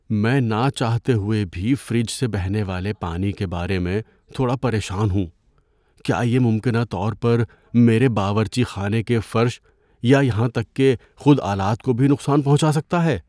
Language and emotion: Urdu, fearful